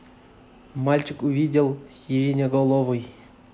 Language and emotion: Russian, neutral